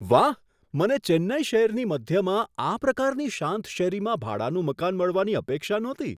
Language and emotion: Gujarati, surprised